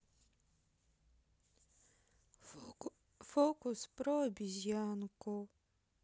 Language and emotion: Russian, sad